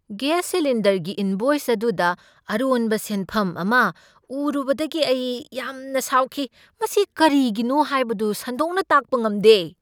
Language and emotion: Manipuri, angry